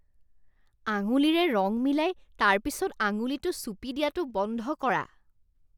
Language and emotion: Assamese, disgusted